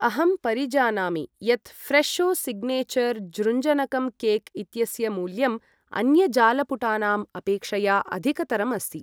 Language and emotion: Sanskrit, neutral